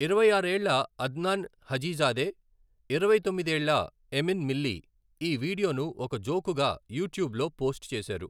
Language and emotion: Telugu, neutral